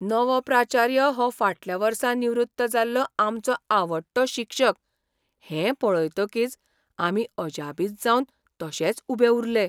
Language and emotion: Goan Konkani, surprised